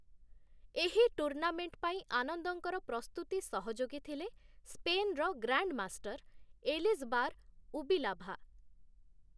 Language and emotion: Odia, neutral